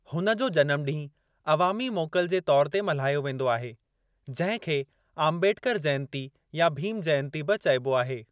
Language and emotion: Sindhi, neutral